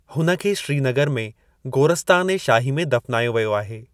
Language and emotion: Sindhi, neutral